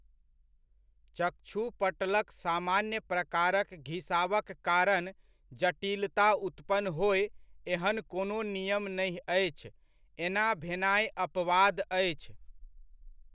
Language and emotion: Maithili, neutral